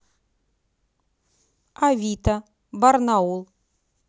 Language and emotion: Russian, neutral